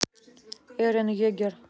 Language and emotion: Russian, neutral